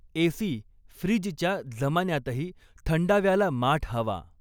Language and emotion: Marathi, neutral